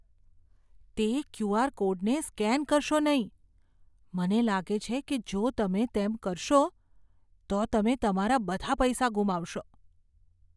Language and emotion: Gujarati, fearful